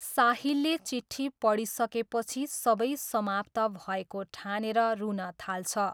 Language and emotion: Nepali, neutral